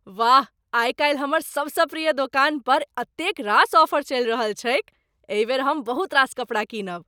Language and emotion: Maithili, surprised